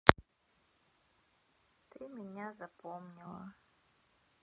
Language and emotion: Russian, sad